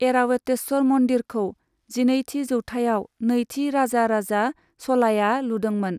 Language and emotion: Bodo, neutral